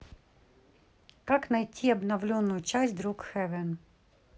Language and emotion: Russian, neutral